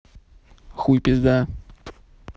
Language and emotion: Russian, neutral